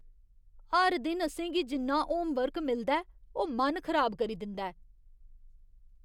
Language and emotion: Dogri, disgusted